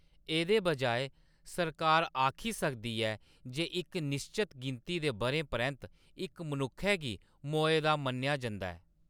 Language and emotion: Dogri, neutral